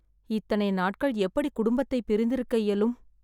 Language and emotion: Tamil, sad